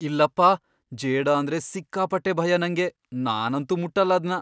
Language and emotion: Kannada, fearful